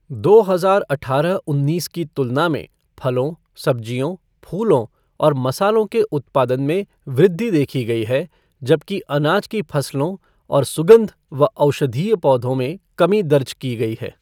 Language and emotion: Hindi, neutral